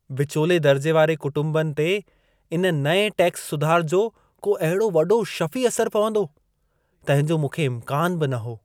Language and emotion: Sindhi, surprised